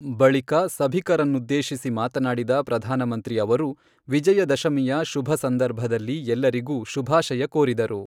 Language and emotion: Kannada, neutral